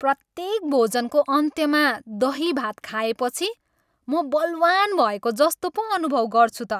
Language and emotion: Nepali, happy